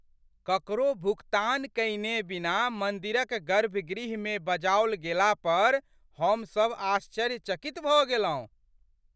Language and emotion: Maithili, surprised